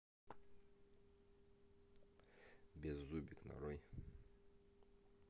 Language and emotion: Russian, neutral